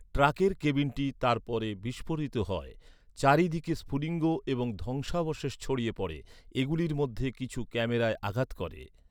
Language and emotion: Bengali, neutral